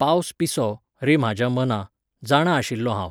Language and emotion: Goan Konkani, neutral